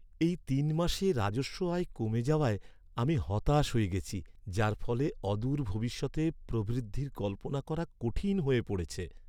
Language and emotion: Bengali, sad